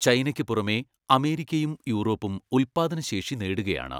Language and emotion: Malayalam, neutral